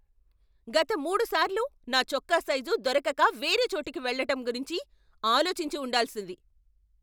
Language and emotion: Telugu, angry